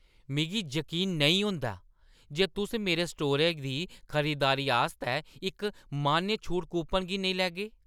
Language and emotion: Dogri, angry